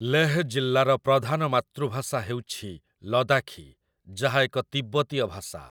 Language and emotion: Odia, neutral